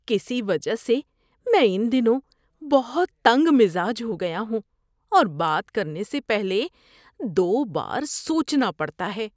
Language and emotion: Urdu, disgusted